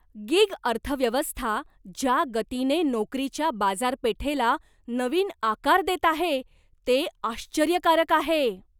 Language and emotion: Marathi, surprised